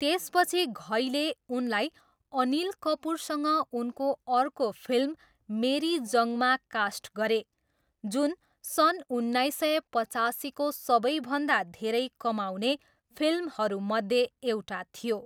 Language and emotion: Nepali, neutral